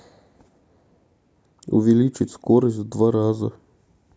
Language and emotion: Russian, neutral